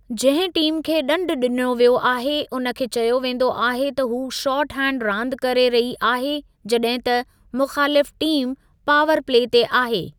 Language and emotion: Sindhi, neutral